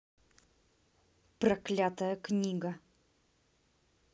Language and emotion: Russian, angry